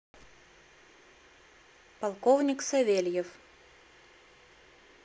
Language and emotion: Russian, neutral